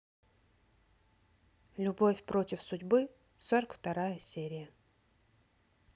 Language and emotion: Russian, neutral